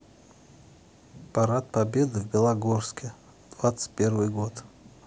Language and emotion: Russian, neutral